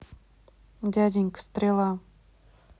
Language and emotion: Russian, neutral